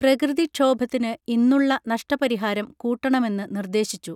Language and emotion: Malayalam, neutral